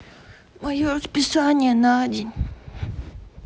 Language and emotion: Russian, sad